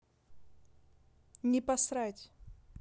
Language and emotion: Russian, neutral